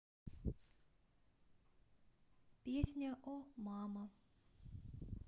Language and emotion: Russian, neutral